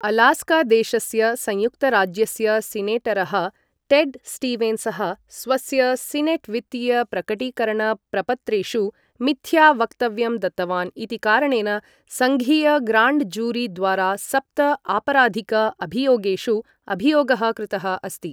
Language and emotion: Sanskrit, neutral